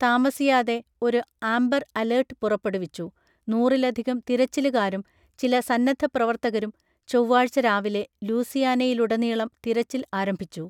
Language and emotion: Malayalam, neutral